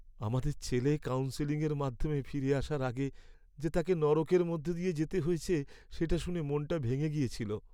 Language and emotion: Bengali, sad